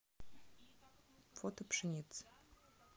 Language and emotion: Russian, neutral